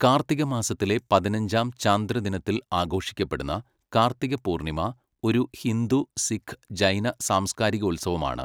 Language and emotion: Malayalam, neutral